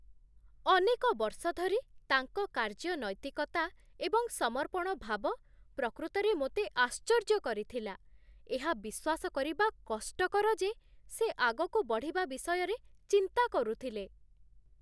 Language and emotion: Odia, surprised